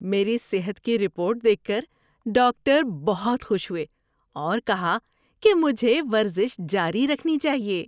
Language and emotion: Urdu, happy